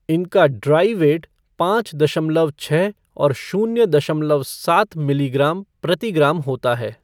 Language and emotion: Hindi, neutral